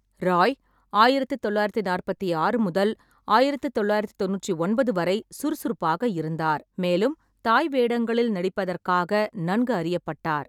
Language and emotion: Tamil, neutral